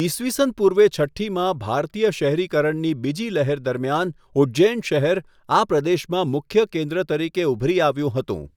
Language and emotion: Gujarati, neutral